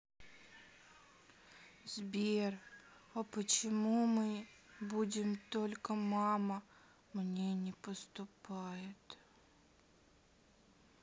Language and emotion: Russian, sad